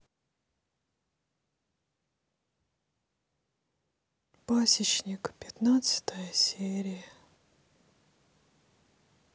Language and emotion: Russian, sad